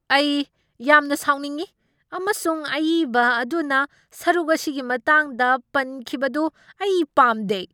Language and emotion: Manipuri, angry